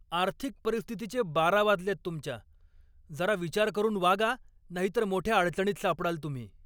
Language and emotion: Marathi, angry